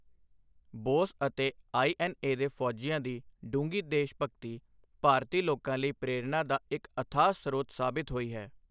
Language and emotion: Punjabi, neutral